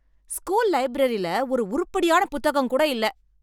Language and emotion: Tamil, angry